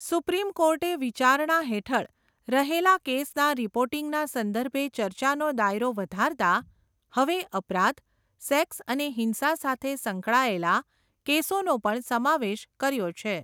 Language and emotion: Gujarati, neutral